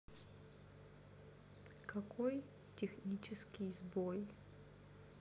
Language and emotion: Russian, sad